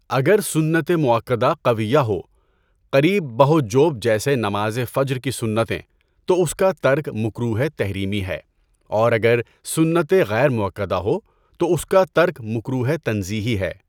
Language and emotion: Urdu, neutral